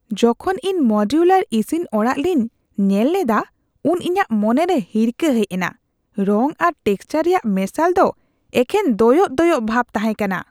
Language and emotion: Santali, disgusted